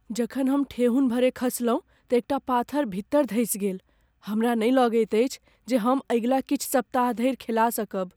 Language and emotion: Maithili, fearful